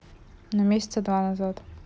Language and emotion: Russian, neutral